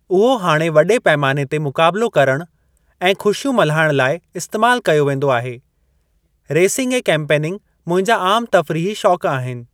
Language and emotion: Sindhi, neutral